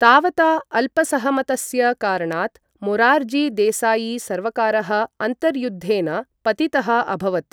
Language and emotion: Sanskrit, neutral